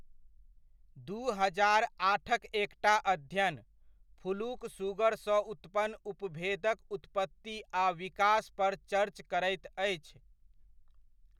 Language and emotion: Maithili, neutral